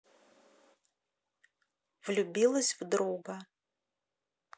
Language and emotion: Russian, neutral